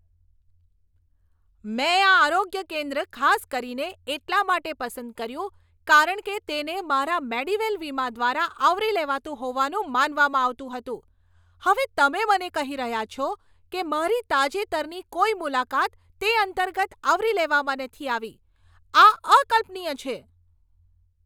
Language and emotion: Gujarati, angry